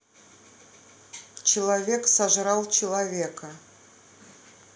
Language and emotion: Russian, neutral